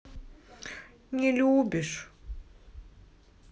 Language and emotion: Russian, sad